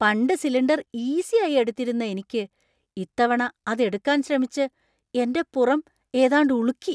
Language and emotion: Malayalam, surprised